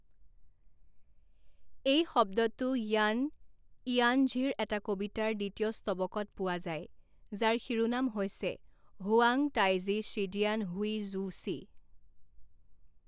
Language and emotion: Assamese, neutral